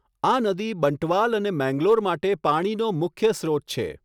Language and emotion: Gujarati, neutral